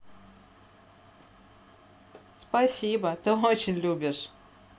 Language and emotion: Russian, positive